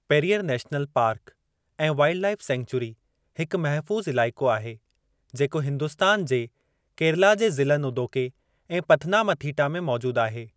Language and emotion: Sindhi, neutral